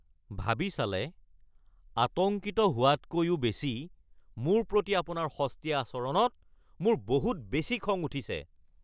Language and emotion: Assamese, angry